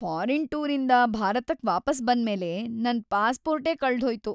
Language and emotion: Kannada, sad